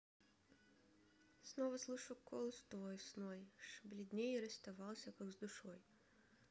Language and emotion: Russian, sad